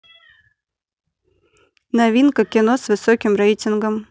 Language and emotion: Russian, neutral